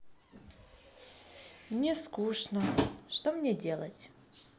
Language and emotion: Russian, sad